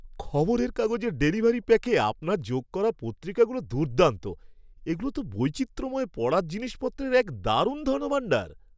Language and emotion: Bengali, happy